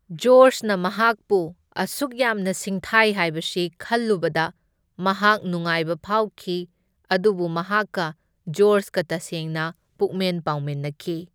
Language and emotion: Manipuri, neutral